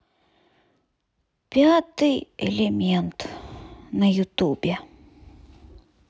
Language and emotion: Russian, sad